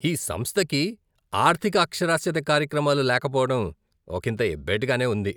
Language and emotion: Telugu, disgusted